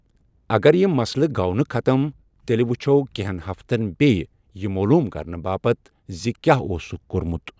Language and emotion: Kashmiri, neutral